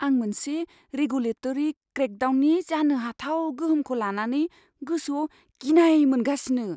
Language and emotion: Bodo, fearful